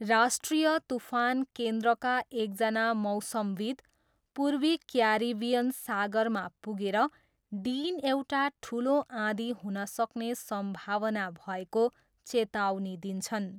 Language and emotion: Nepali, neutral